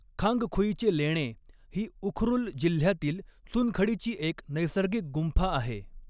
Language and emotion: Marathi, neutral